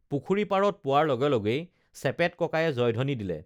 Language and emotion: Assamese, neutral